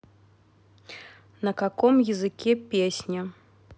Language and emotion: Russian, neutral